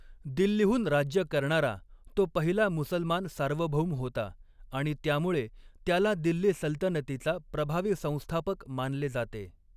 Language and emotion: Marathi, neutral